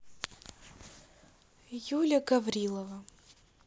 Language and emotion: Russian, neutral